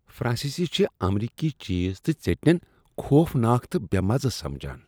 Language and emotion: Kashmiri, disgusted